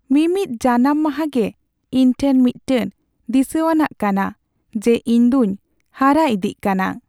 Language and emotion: Santali, sad